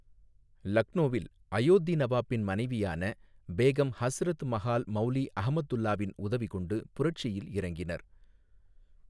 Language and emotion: Tamil, neutral